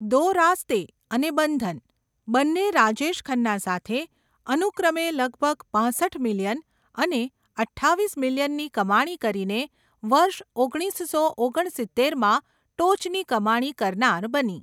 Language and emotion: Gujarati, neutral